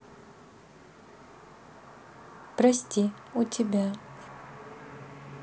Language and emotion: Russian, sad